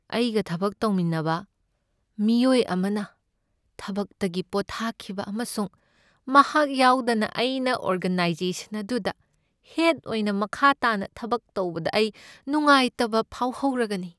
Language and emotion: Manipuri, sad